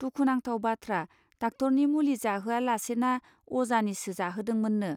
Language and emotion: Bodo, neutral